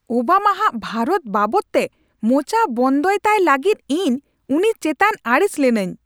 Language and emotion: Santali, angry